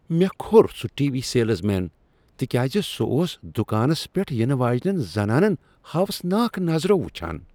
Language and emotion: Kashmiri, disgusted